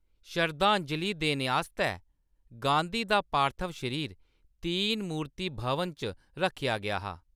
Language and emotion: Dogri, neutral